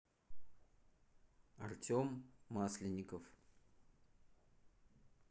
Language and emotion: Russian, neutral